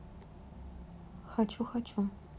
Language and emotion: Russian, neutral